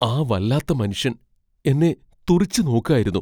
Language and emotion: Malayalam, fearful